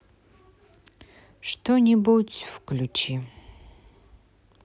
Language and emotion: Russian, sad